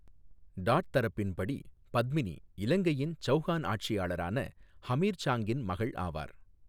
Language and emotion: Tamil, neutral